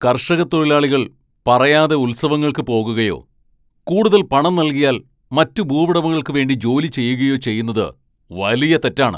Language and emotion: Malayalam, angry